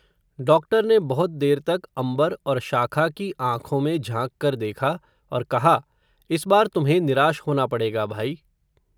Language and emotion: Hindi, neutral